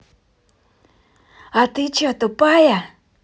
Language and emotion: Russian, angry